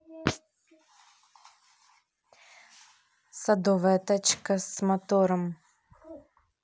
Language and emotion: Russian, neutral